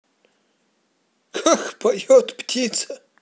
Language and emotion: Russian, positive